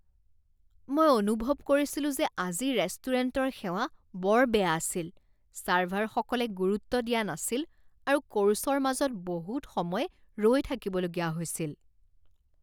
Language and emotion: Assamese, disgusted